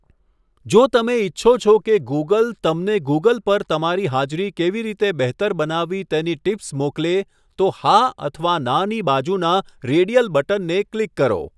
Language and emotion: Gujarati, neutral